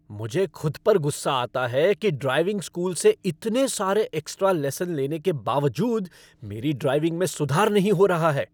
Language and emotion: Hindi, angry